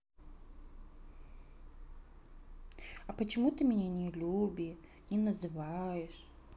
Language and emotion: Russian, sad